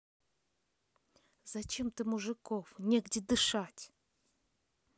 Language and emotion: Russian, angry